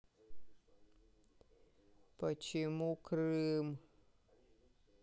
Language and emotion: Russian, sad